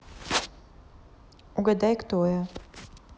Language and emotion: Russian, neutral